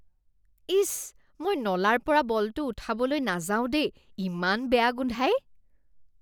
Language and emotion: Assamese, disgusted